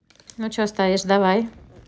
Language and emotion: Russian, neutral